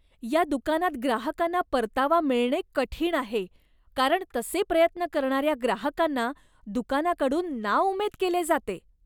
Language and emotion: Marathi, disgusted